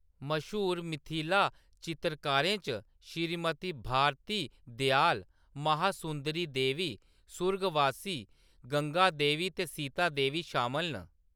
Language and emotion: Dogri, neutral